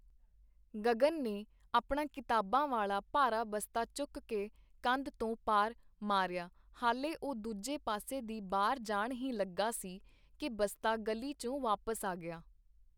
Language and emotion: Punjabi, neutral